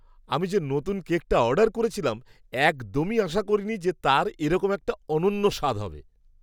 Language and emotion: Bengali, surprised